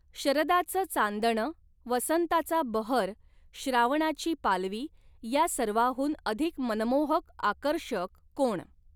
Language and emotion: Marathi, neutral